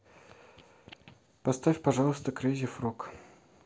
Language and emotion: Russian, neutral